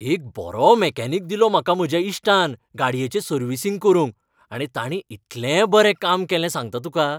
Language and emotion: Goan Konkani, happy